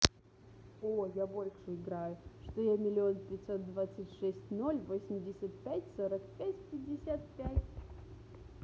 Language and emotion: Russian, positive